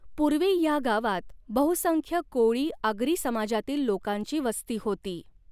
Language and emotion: Marathi, neutral